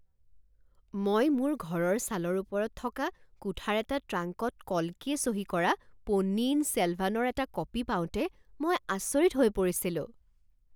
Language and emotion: Assamese, surprised